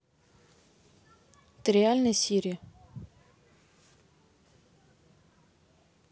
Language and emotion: Russian, neutral